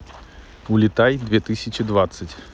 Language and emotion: Russian, neutral